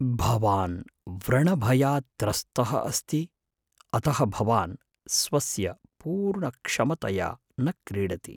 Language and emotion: Sanskrit, fearful